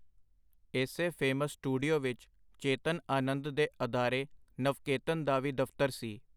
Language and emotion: Punjabi, neutral